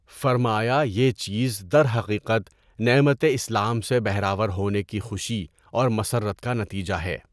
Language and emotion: Urdu, neutral